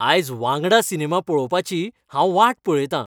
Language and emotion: Goan Konkani, happy